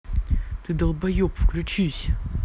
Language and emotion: Russian, angry